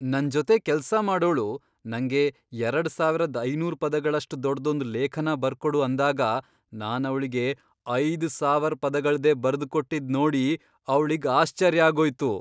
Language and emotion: Kannada, surprised